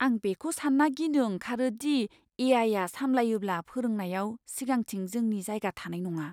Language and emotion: Bodo, fearful